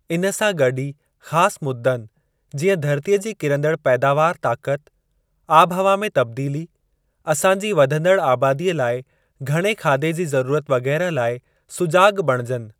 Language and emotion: Sindhi, neutral